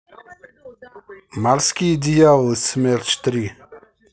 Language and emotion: Russian, neutral